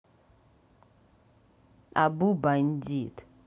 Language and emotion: Russian, neutral